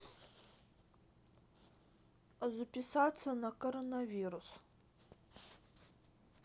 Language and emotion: Russian, neutral